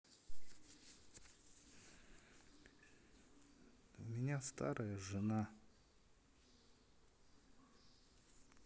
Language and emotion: Russian, sad